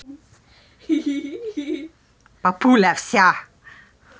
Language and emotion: Russian, positive